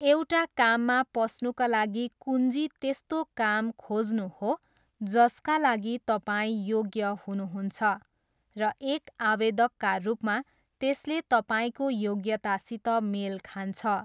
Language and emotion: Nepali, neutral